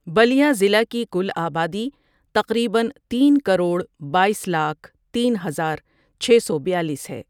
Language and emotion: Urdu, neutral